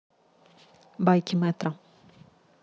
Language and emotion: Russian, neutral